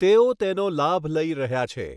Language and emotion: Gujarati, neutral